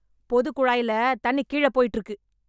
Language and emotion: Tamil, angry